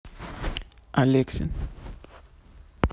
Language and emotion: Russian, neutral